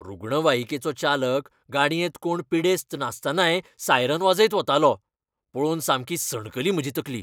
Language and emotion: Goan Konkani, angry